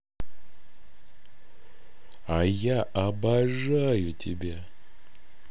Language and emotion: Russian, positive